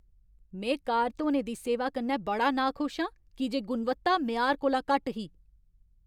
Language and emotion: Dogri, angry